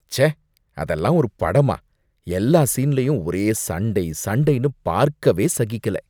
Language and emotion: Tamil, disgusted